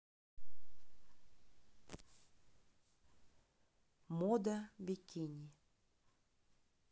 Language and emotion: Russian, neutral